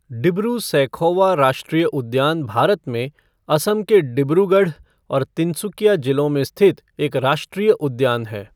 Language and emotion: Hindi, neutral